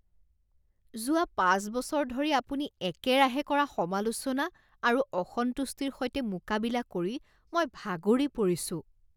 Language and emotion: Assamese, disgusted